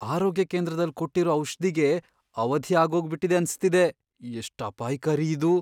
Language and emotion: Kannada, fearful